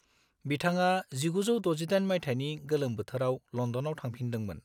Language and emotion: Bodo, neutral